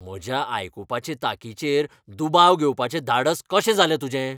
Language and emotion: Goan Konkani, angry